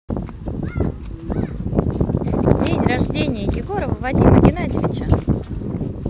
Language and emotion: Russian, positive